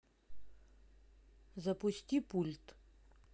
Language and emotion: Russian, neutral